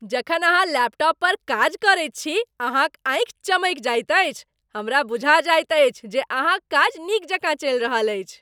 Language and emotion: Maithili, happy